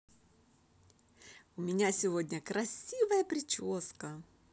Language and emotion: Russian, positive